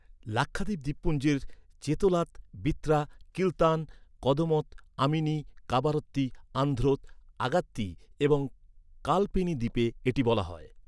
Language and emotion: Bengali, neutral